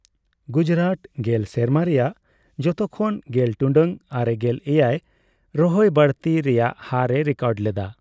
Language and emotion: Santali, neutral